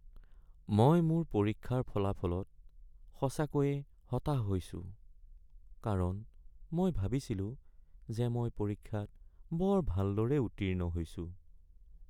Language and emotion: Assamese, sad